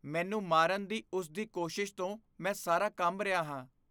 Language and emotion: Punjabi, fearful